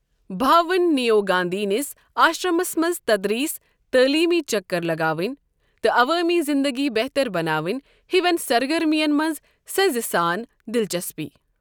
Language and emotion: Kashmiri, neutral